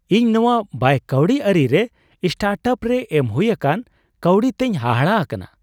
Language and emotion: Santali, surprised